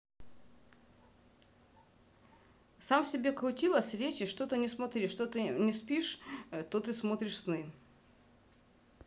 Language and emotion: Russian, positive